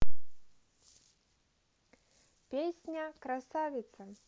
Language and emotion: Russian, neutral